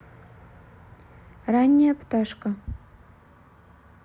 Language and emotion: Russian, neutral